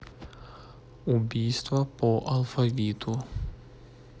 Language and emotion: Russian, neutral